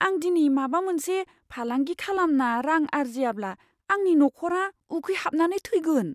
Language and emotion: Bodo, fearful